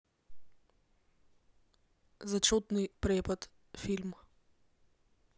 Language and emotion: Russian, neutral